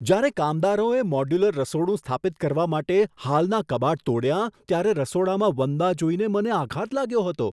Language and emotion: Gujarati, surprised